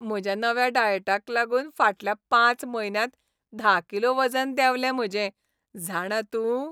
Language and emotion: Goan Konkani, happy